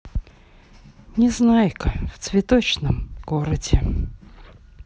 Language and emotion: Russian, sad